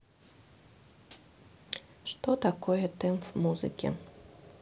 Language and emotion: Russian, neutral